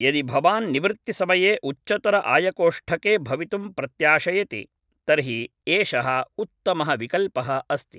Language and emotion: Sanskrit, neutral